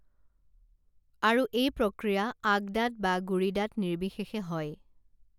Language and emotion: Assamese, neutral